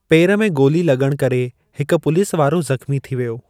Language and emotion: Sindhi, neutral